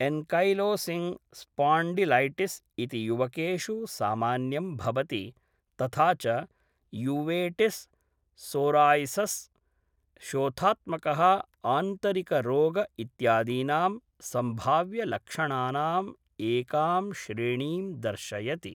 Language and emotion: Sanskrit, neutral